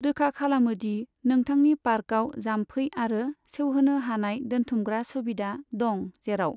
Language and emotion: Bodo, neutral